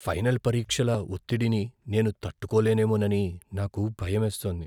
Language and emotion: Telugu, fearful